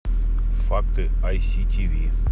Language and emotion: Russian, neutral